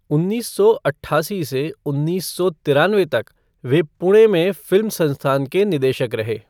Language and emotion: Hindi, neutral